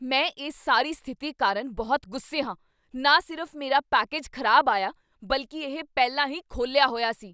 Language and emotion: Punjabi, angry